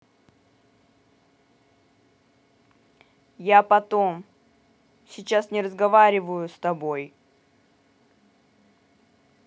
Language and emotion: Russian, angry